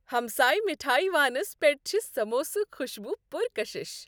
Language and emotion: Kashmiri, happy